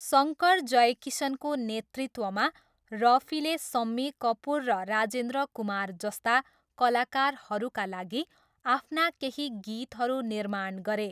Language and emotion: Nepali, neutral